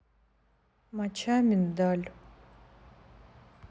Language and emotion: Russian, neutral